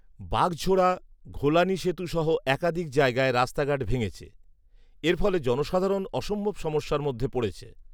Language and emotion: Bengali, neutral